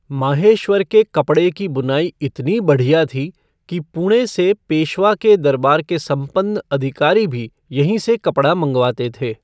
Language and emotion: Hindi, neutral